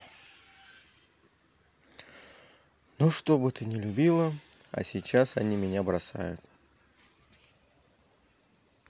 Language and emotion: Russian, sad